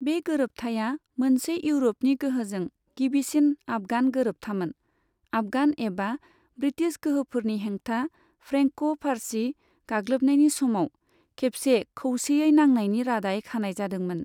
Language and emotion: Bodo, neutral